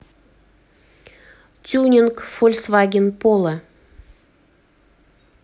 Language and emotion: Russian, neutral